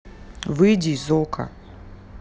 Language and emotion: Russian, neutral